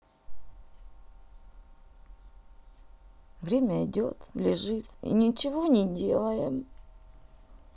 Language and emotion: Russian, sad